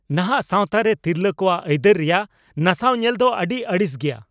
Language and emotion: Santali, angry